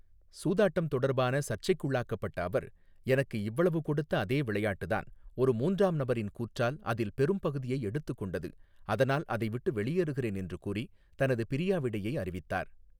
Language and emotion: Tamil, neutral